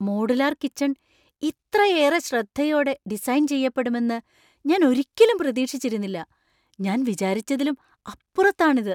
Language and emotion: Malayalam, surprised